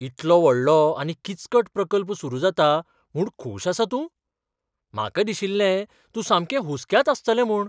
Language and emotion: Goan Konkani, surprised